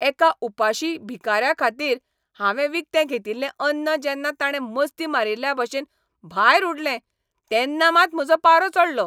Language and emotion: Goan Konkani, angry